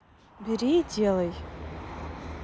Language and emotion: Russian, neutral